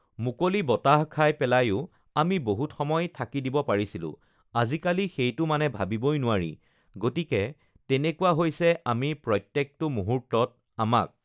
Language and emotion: Assamese, neutral